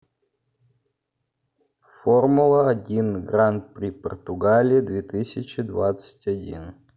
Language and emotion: Russian, neutral